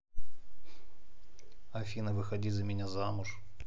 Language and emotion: Russian, neutral